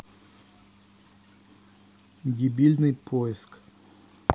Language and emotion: Russian, neutral